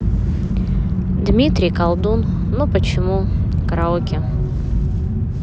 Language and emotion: Russian, neutral